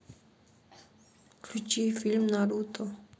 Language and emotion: Russian, neutral